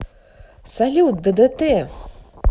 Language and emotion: Russian, positive